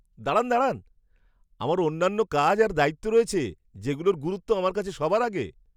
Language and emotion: Bengali, surprised